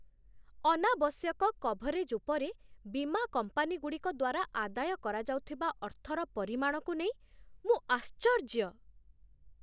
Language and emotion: Odia, surprised